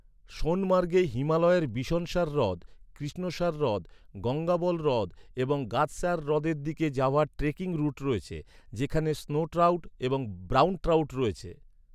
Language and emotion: Bengali, neutral